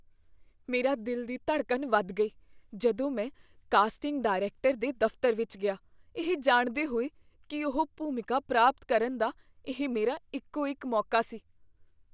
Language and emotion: Punjabi, fearful